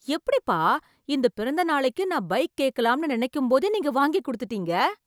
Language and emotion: Tamil, surprised